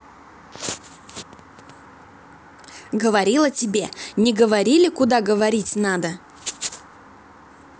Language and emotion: Russian, angry